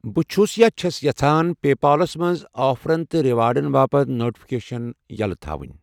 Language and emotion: Kashmiri, neutral